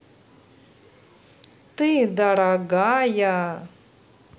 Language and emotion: Russian, positive